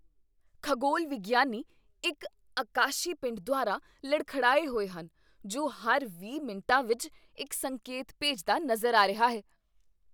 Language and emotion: Punjabi, surprised